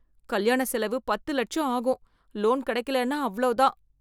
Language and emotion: Tamil, fearful